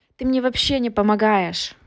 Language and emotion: Russian, angry